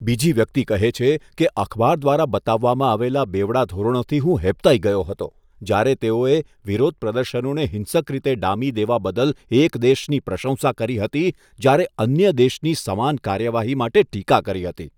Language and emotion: Gujarati, disgusted